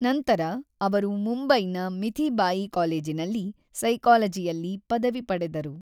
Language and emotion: Kannada, neutral